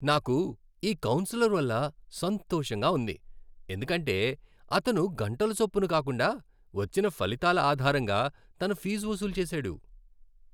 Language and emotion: Telugu, happy